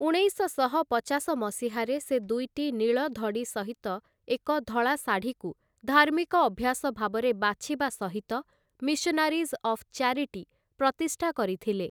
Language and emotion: Odia, neutral